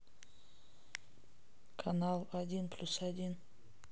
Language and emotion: Russian, neutral